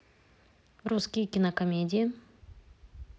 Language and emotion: Russian, neutral